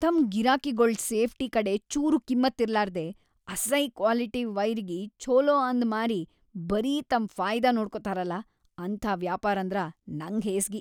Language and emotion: Kannada, disgusted